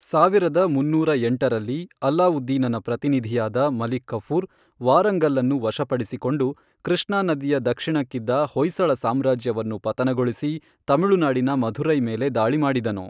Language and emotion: Kannada, neutral